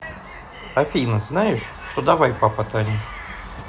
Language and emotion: Russian, neutral